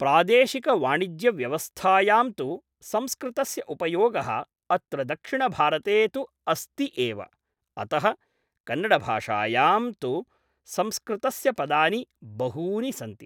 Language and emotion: Sanskrit, neutral